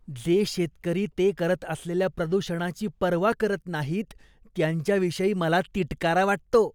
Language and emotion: Marathi, disgusted